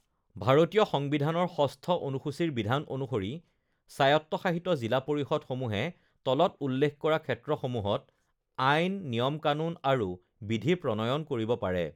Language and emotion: Assamese, neutral